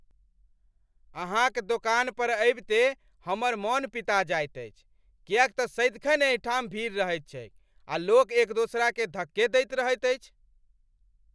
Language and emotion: Maithili, angry